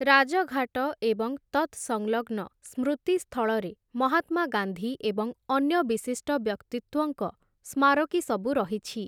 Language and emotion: Odia, neutral